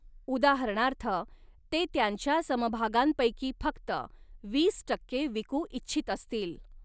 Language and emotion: Marathi, neutral